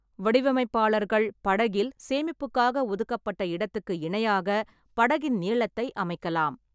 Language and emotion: Tamil, neutral